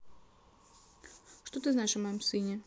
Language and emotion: Russian, neutral